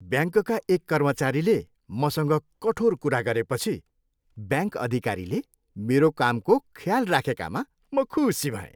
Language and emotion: Nepali, happy